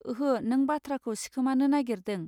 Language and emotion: Bodo, neutral